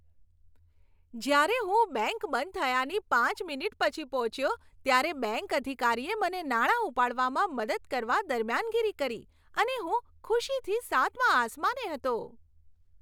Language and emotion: Gujarati, happy